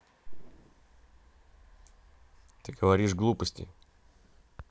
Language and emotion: Russian, neutral